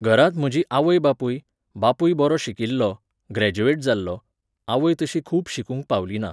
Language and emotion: Goan Konkani, neutral